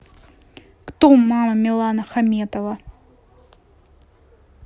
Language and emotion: Russian, neutral